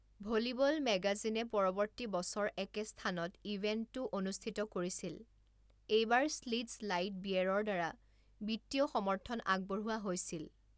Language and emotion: Assamese, neutral